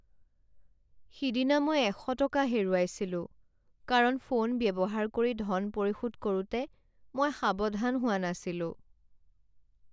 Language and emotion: Assamese, sad